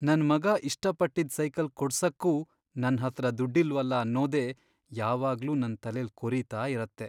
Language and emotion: Kannada, sad